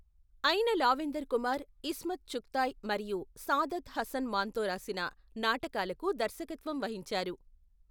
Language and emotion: Telugu, neutral